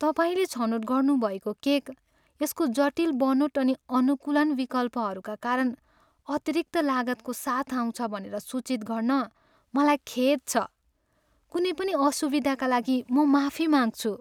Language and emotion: Nepali, sad